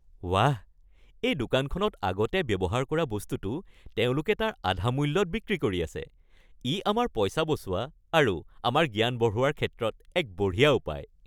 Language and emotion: Assamese, happy